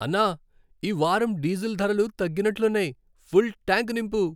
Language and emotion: Telugu, happy